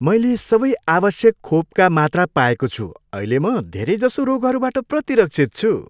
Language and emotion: Nepali, happy